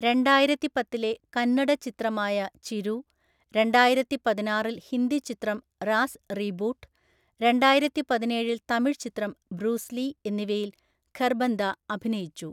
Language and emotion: Malayalam, neutral